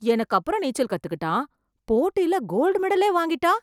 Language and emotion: Tamil, surprised